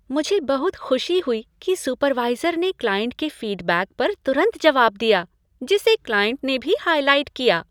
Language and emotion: Hindi, happy